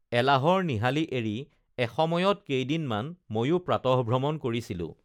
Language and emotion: Assamese, neutral